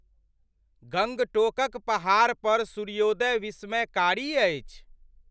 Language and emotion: Maithili, surprised